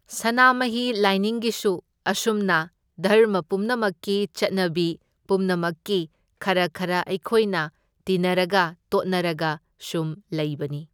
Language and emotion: Manipuri, neutral